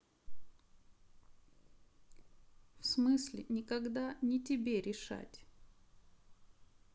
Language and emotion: Russian, sad